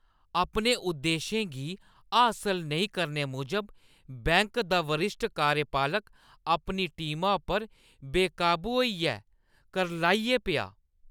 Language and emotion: Dogri, angry